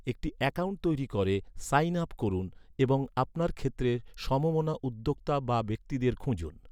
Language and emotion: Bengali, neutral